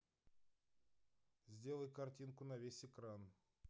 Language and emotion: Russian, neutral